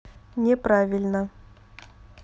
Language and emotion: Russian, neutral